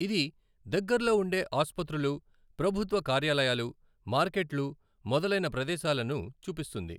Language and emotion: Telugu, neutral